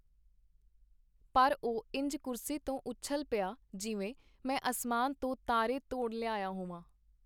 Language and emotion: Punjabi, neutral